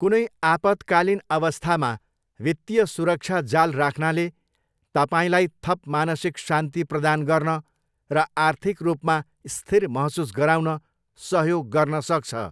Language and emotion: Nepali, neutral